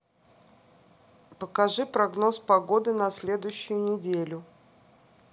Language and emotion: Russian, neutral